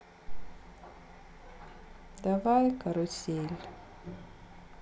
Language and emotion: Russian, sad